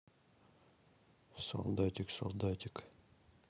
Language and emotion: Russian, neutral